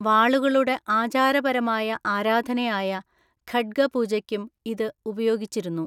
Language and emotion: Malayalam, neutral